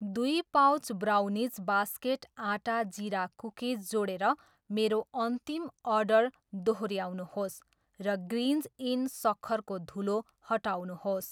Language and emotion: Nepali, neutral